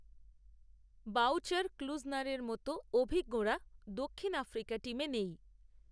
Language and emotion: Bengali, neutral